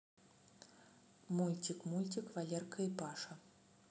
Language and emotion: Russian, neutral